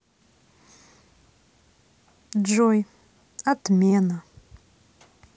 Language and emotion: Russian, neutral